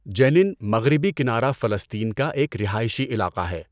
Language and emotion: Urdu, neutral